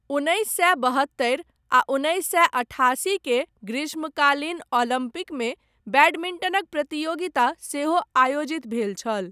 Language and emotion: Maithili, neutral